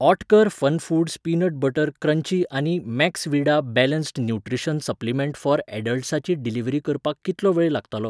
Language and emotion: Goan Konkani, neutral